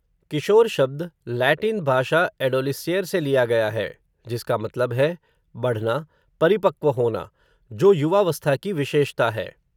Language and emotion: Hindi, neutral